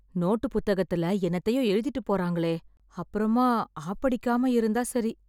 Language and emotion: Tamil, fearful